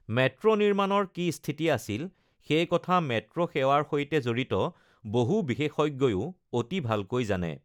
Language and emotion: Assamese, neutral